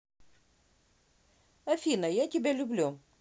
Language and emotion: Russian, neutral